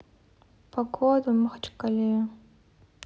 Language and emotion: Russian, sad